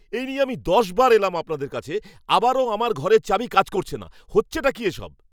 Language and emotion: Bengali, angry